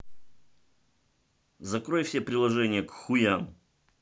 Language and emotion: Russian, angry